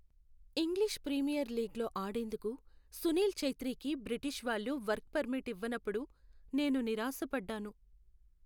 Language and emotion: Telugu, sad